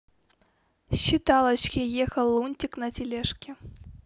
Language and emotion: Russian, neutral